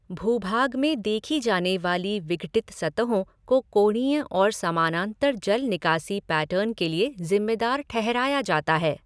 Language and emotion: Hindi, neutral